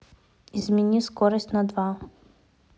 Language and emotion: Russian, neutral